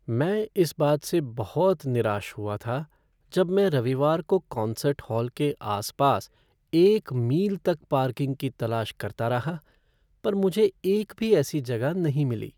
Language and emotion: Hindi, sad